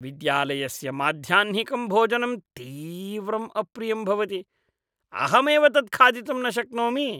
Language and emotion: Sanskrit, disgusted